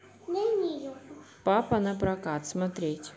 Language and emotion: Russian, neutral